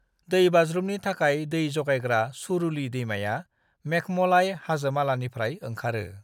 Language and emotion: Bodo, neutral